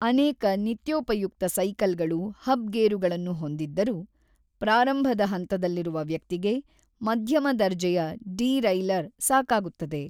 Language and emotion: Kannada, neutral